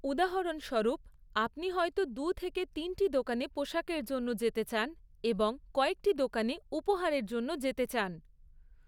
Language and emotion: Bengali, neutral